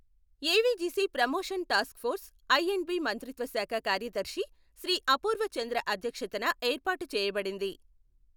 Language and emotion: Telugu, neutral